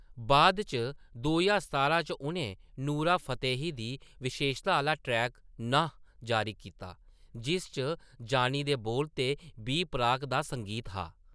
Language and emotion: Dogri, neutral